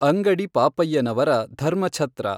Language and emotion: Kannada, neutral